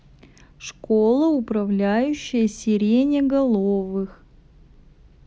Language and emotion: Russian, neutral